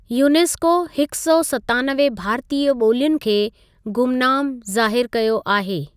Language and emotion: Sindhi, neutral